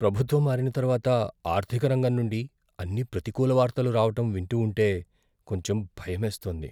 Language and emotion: Telugu, fearful